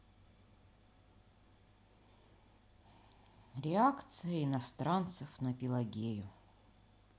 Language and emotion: Russian, neutral